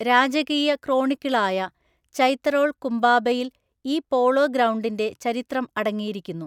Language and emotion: Malayalam, neutral